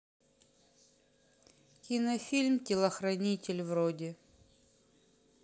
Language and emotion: Russian, sad